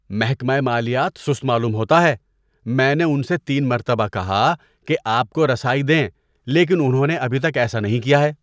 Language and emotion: Urdu, disgusted